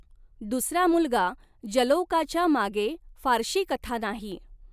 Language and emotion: Marathi, neutral